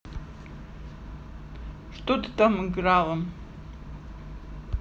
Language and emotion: Russian, neutral